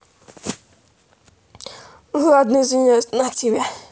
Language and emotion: Russian, neutral